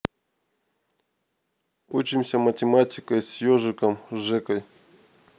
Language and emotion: Russian, neutral